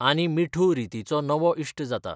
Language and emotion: Goan Konkani, neutral